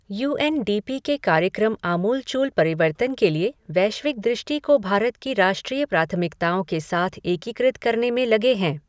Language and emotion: Hindi, neutral